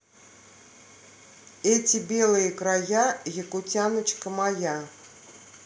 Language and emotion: Russian, positive